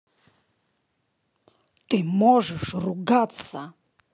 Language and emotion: Russian, angry